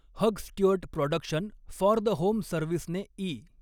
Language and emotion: Marathi, neutral